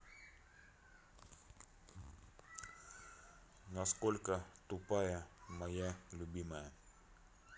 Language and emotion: Russian, neutral